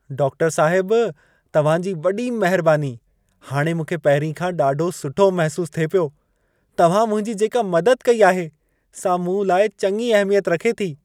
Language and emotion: Sindhi, happy